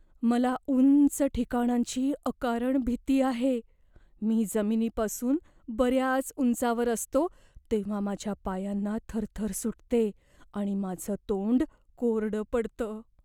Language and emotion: Marathi, fearful